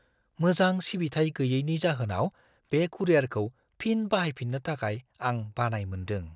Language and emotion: Bodo, fearful